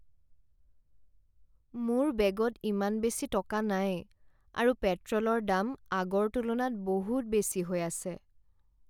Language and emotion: Assamese, sad